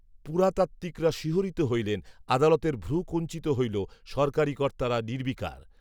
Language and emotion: Bengali, neutral